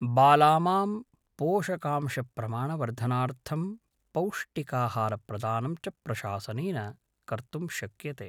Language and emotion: Sanskrit, neutral